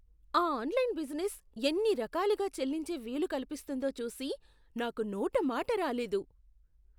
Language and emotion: Telugu, surprised